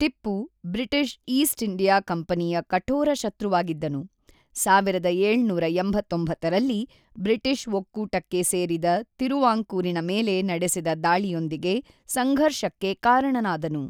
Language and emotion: Kannada, neutral